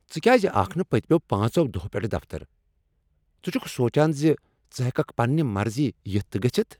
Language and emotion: Kashmiri, angry